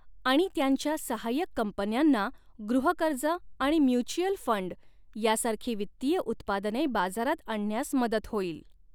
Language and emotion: Marathi, neutral